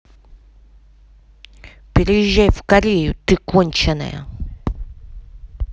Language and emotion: Russian, angry